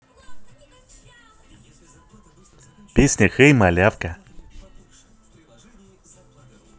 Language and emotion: Russian, positive